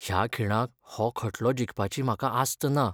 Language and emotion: Goan Konkani, sad